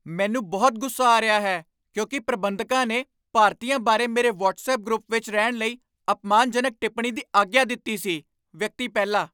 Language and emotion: Punjabi, angry